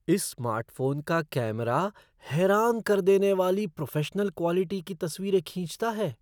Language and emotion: Hindi, surprised